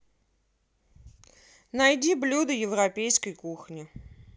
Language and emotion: Russian, neutral